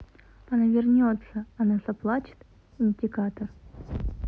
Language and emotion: Russian, neutral